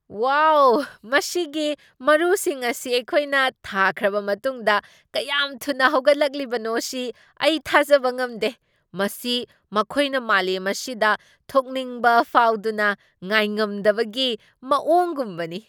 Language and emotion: Manipuri, surprised